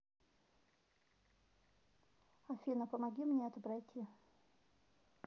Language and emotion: Russian, neutral